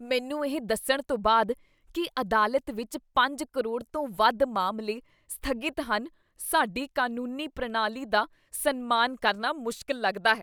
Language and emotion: Punjabi, disgusted